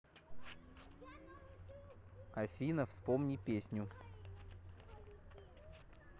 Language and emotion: Russian, neutral